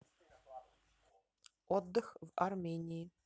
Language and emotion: Russian, neutral